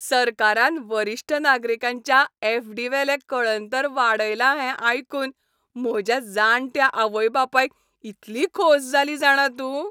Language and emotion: Goan Konkani, happy